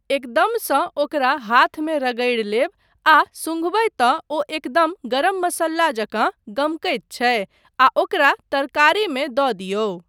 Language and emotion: Maithili, neutral